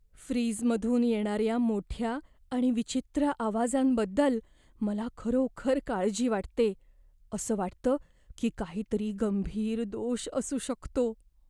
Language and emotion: Marathi, fearful